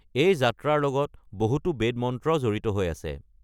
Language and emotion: Assamese, neutral